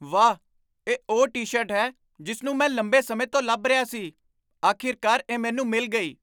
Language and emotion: Punjabi, surprised